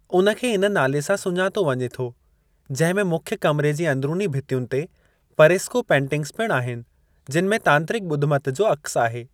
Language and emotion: Sindhi, neutral